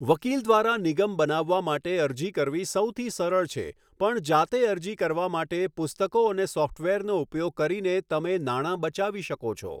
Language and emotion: Gujarati, neutral